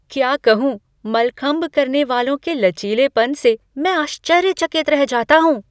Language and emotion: Hindi, surprised